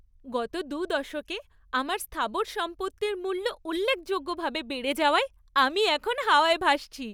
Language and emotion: Bengali, happy